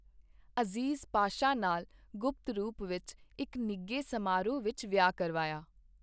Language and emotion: Punjabi, neutral